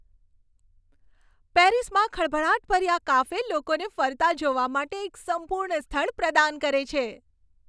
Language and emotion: Gujarati, happy